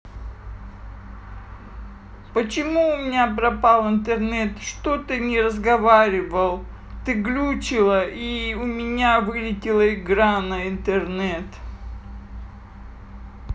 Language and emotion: Russian, sad